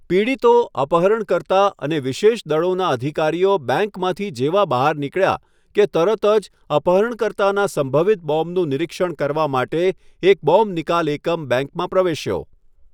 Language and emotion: Gujarati, neutral